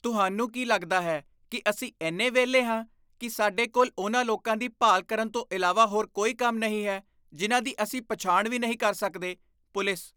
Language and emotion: Punjabi, disgusted